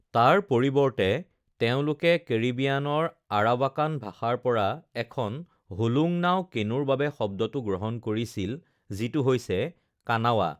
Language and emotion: Assamese, neutral